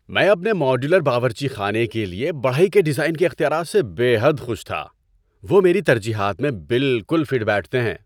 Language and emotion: Urdu, happy